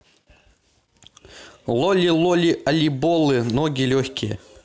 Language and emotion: Russian, neutral